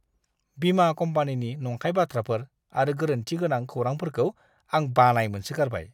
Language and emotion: Bodo, disgusted